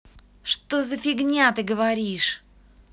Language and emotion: Russian, angry